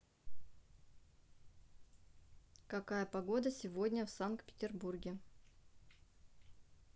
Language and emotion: Russian, neutral